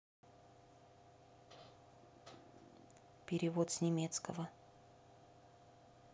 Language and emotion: Russian, neutral